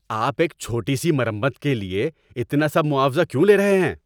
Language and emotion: Urdu, angry